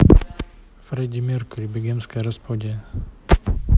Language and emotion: Russian, neutral